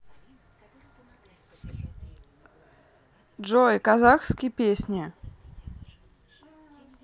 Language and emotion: Russian, neutral